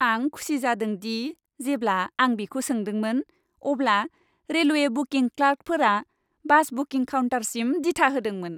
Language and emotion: Bodo, happy